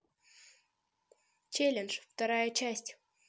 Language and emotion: Russian, positive